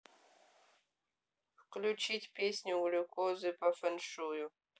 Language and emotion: Russian, neutral